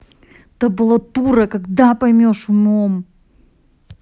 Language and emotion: Russian, angry